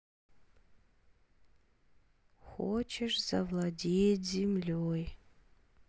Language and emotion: Russian, sad